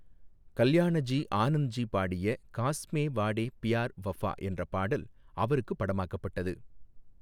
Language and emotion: Tamil, neutral